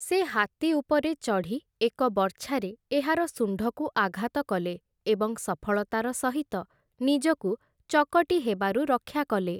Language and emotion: Odia, neutral